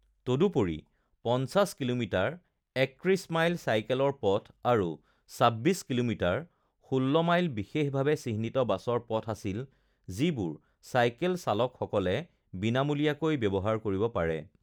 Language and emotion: Assamese, neutral